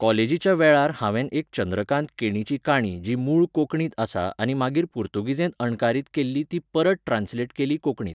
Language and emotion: Goan Konkani, neutral